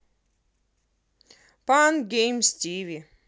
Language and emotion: Russian, positive